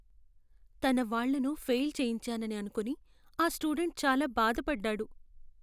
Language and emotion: Telugu, sad